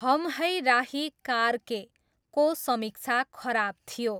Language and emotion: Nepali, neutral